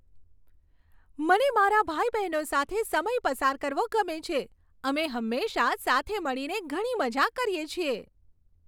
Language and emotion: Gujarati, happy